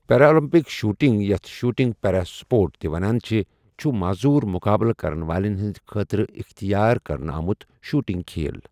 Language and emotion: Kashmiri, neutral